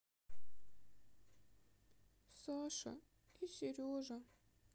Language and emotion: Russian, sad